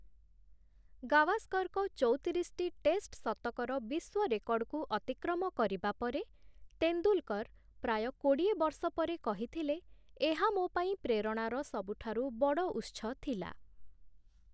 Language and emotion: Odia, neutral